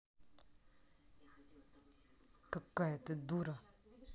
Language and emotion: Russian, angry